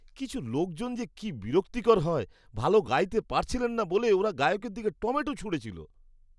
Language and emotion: Bengali, disgusted